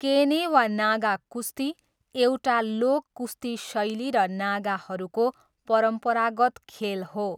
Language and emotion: Nepali, neutral